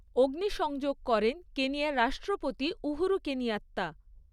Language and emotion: Bengali, neutral